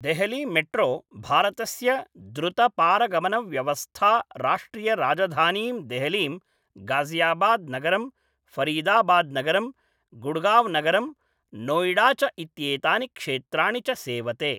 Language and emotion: Sanskrit, neutral